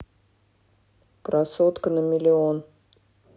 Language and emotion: Russian, neutral